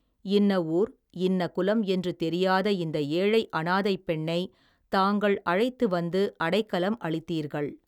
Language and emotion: Tamil, neutral